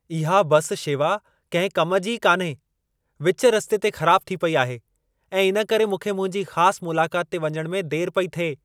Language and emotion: Sindhi, angry